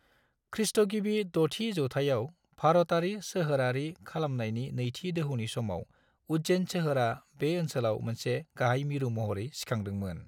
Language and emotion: Bodo, neutral